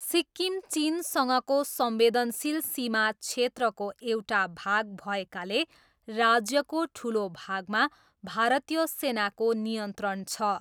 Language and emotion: Nepali, neutral